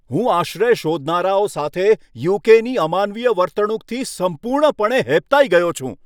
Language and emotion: Gujarati, angry